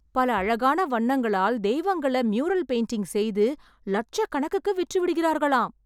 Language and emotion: Tamil, surprised